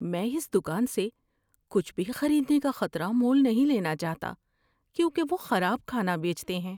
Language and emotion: Urdu, fearful